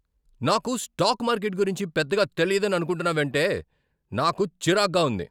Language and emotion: Telugu, angry